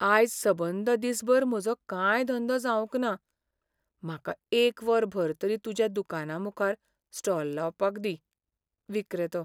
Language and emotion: Goan Konkani, sad